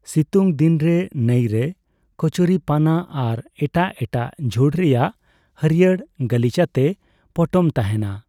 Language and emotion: Santali, neutral